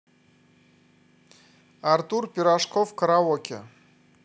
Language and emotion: Russian, neutral